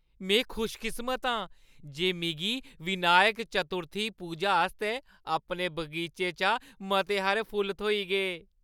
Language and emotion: Dogri, happy